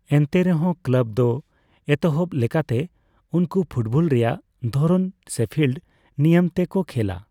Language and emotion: Santali, neutral